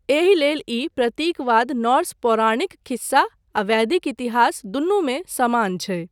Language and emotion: Maithili, neutral